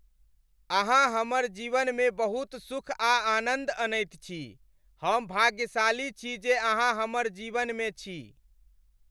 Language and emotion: Maithili, happy